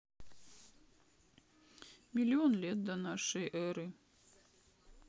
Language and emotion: Russian, sad